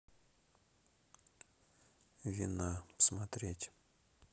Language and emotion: Russian, neutral